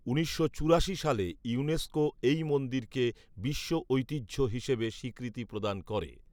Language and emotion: Bengali, neutral